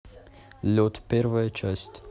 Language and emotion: Russian, neutral